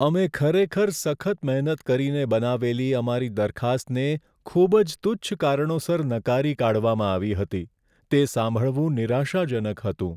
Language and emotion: Gujarati, sad